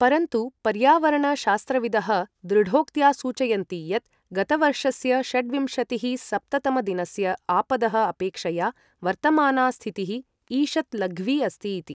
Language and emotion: Sanskrit, neutral